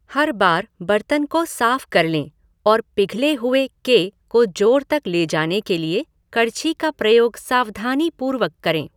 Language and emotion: Hindi, neutral